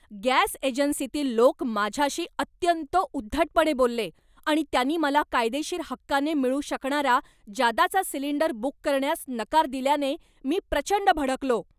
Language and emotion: Marathi, angry